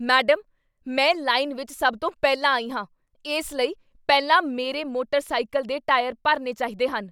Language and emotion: Punjabi, angry